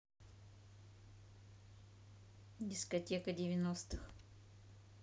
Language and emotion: Russian, neutral